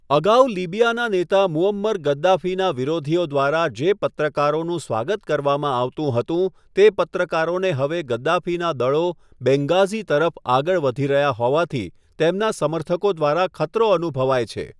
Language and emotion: Gujarati, neutral